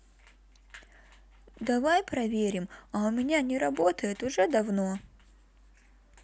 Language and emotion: Russian, neutral